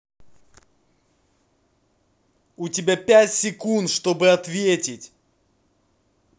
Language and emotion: Russian, angry